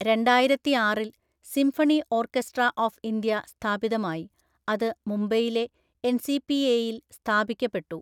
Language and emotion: Malayalam, neutral